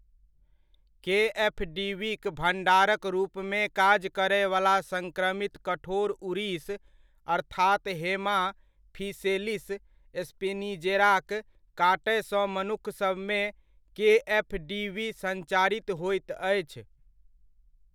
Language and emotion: Maithili, neutral